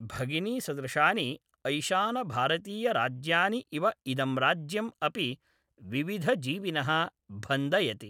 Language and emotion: Sanskrit, neutral